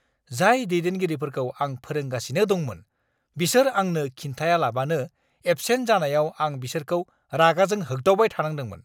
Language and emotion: Bodo, angry